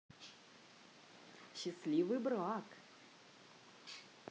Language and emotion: Russian, positive